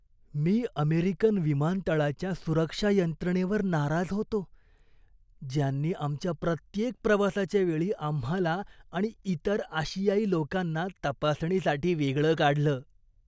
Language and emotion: Marathi, disgusted